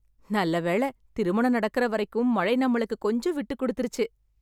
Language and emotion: Tamil, happy